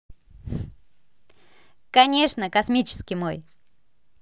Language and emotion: Russian, positive